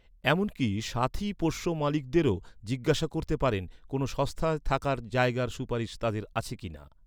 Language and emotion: Bengali, neutral